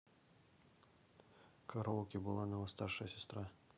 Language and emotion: Russian, neutral